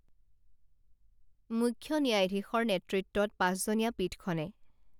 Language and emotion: Assamese, neutral